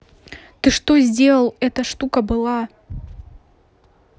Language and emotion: Russian, angry